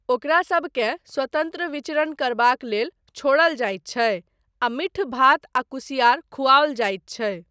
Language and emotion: Maithili, neutral